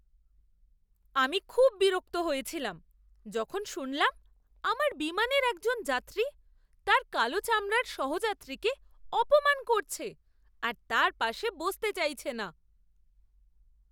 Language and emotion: Bengali, disgusted